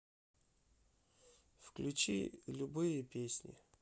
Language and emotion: Russian, sad